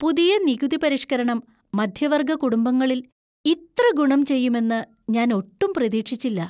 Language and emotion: Malayalam, surprised